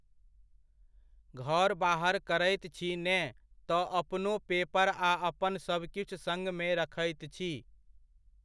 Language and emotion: Maithili, neutral